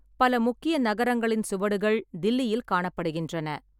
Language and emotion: Tamil, neutral